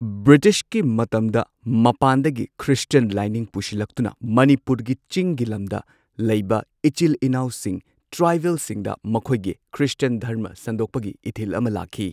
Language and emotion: Manipuri, neutral